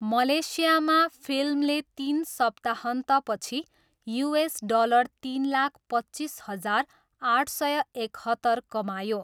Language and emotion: Nepali, neutral